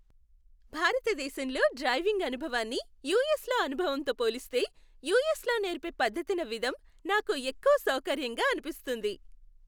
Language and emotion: Telugu, happy